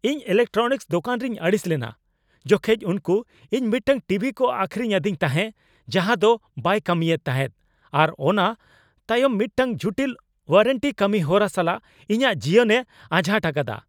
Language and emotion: Santali, angry